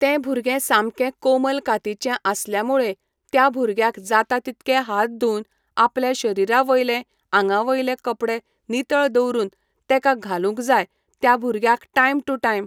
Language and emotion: Goan Konkani, neutral